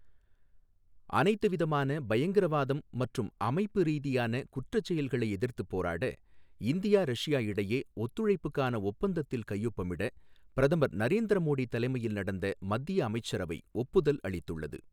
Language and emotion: Tamil, neutral